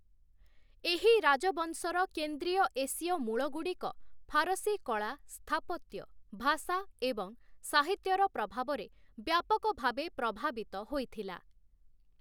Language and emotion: Odia, neutral